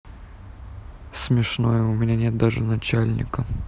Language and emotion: Russian, sad